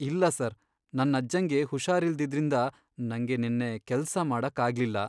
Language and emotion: Kannada, sad